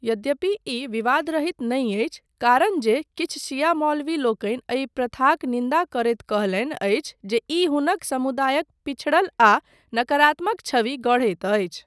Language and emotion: Maithili, neutral